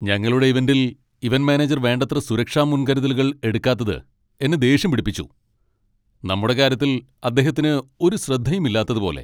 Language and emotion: Malayalam, angry